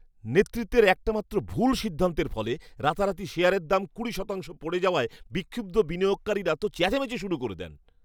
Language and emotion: Bengali, angry